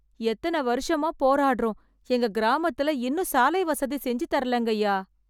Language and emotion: Tamil, sad